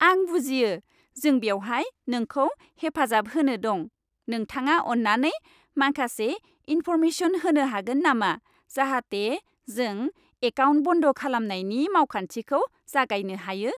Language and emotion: Bodo, happy